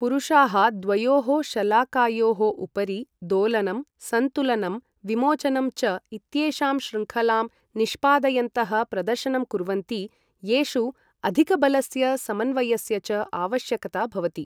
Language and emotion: Sanskrit, neutral